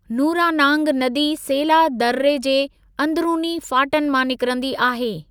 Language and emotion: Sindhi, neutral